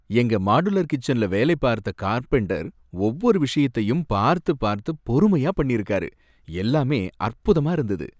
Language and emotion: Tamil, happy